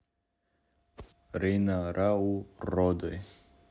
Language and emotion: Russian, neutral